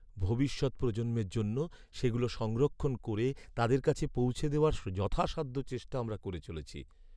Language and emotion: Bengali, sad